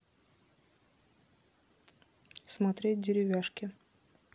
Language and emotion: Russian, neutral